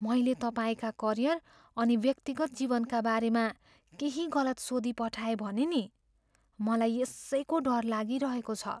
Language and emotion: Nepali, fearful